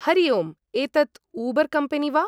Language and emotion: Sanskrit, neutral